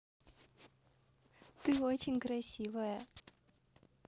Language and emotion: Russian, positive